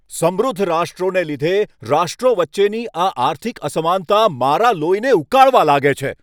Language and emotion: Gujarati, angry